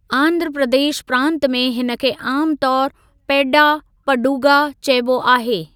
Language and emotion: Sindhi, neutral